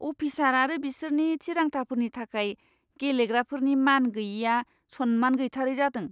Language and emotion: Bodo, disgusted